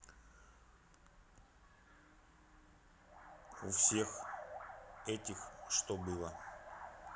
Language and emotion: Russian, neutral